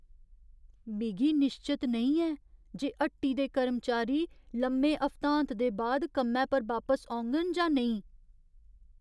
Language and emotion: Dogri, fearful